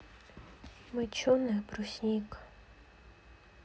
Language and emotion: Russian, sad